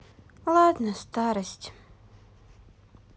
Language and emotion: Russian, sad